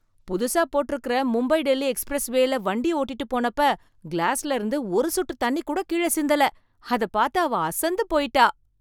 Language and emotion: Tamil, surprised